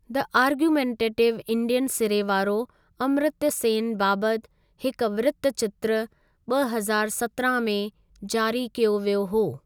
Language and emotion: Sindhi, neutral